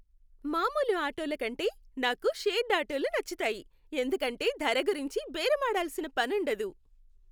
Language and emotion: Telugu, happy